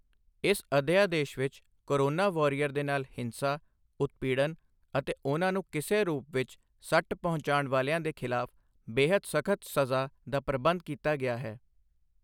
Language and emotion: Punjabi, neutral